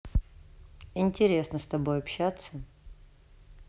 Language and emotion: Russian, neutral